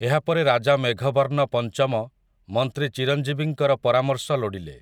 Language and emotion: Odia, neutral